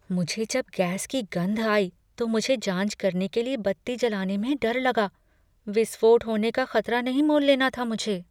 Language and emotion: Hindi, fearful